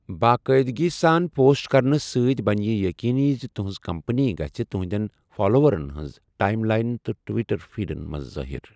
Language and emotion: Kashmiri, neutral